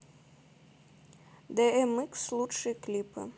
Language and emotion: Russian, neutral